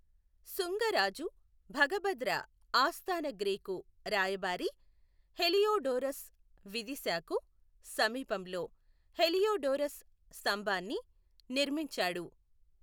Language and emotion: Telugu, neutral